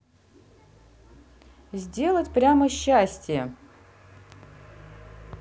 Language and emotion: Russian, neutral